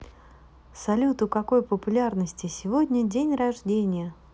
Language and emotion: Russian, positive